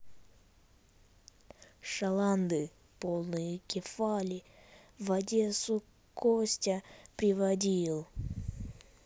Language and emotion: Russian, neutral